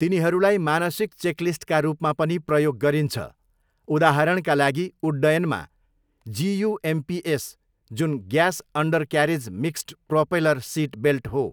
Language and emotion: Nepali, neutral